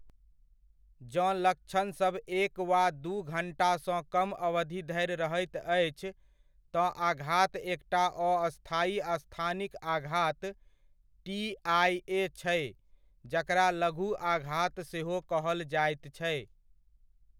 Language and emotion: Maithili, neutral